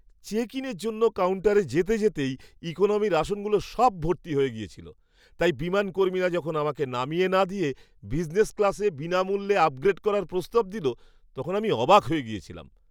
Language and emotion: Bengali, surprised